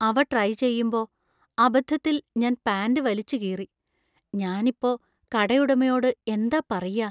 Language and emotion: Malayalam, fearful